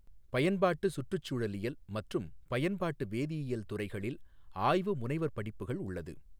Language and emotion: Tamil, neutral